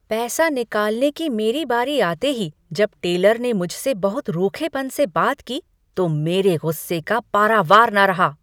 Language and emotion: Hindi, angry